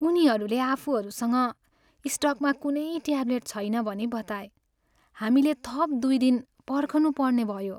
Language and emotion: Nepali, sad